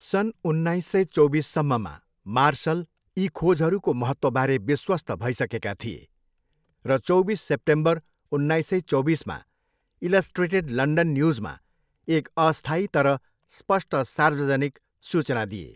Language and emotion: Nepali, neutral